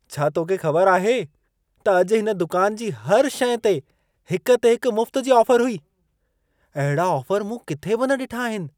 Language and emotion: Sindhi, surprised